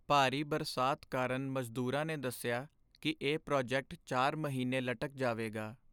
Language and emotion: Punjabi, sad